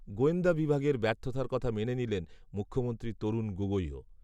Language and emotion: Bengali, neutral